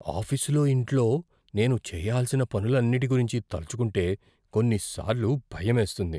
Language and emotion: Telugu, fearful